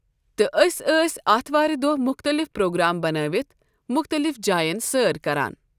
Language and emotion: Kashmiri, neutral